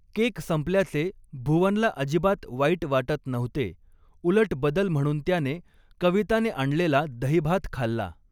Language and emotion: Marathi, neutral